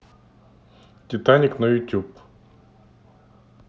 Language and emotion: Russian, neutral